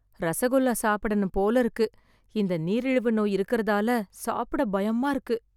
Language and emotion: Tamil, fearful